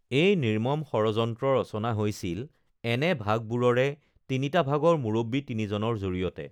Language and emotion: Assamese, neutral